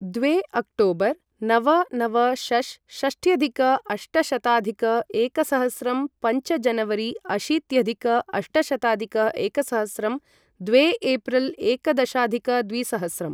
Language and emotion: Sanskrit, neutral